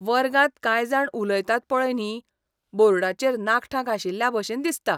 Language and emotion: Goan Konkani, disgusted